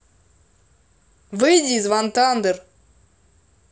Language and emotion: Russian, angry